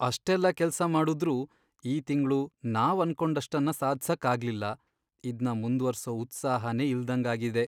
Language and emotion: Kannada, sad